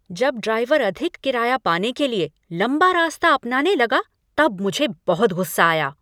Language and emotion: Hindi, angry